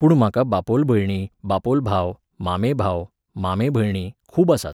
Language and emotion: Goan Konkani, neutral